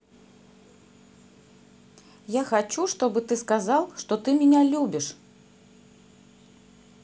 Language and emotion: Russian, neutral